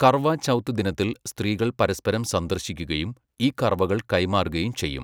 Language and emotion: Malayalam, neutral